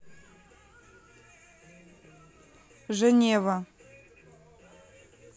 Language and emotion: Russian, neutral